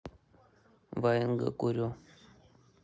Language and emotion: Russian, neutral